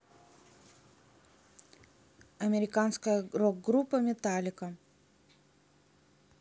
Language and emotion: Russian, neutral